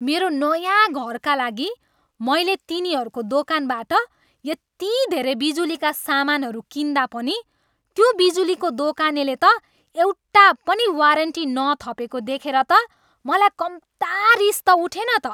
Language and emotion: Nepali, angry